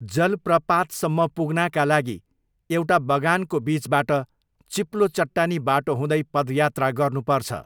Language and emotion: Nepali, neutral